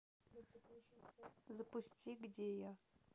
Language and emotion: Russian, neutral